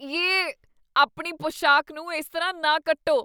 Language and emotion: Punjabi, disgusted